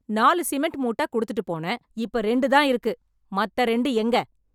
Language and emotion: Tamil, angry